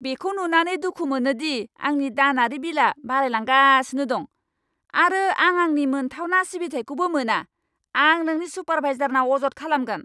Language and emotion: Bodo, angry